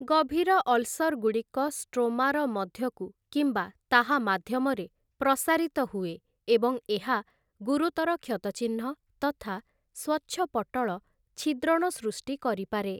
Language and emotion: Odia, neutral